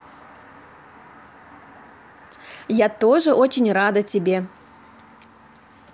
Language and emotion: Russian, positive